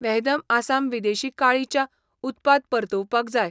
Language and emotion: Goan Konkani, neutral